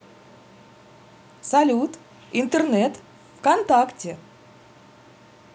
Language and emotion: Russian, positive